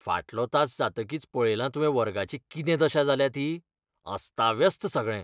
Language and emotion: Goan Konkani, disgusted